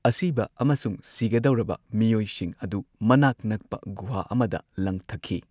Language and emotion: Manipuri, neutral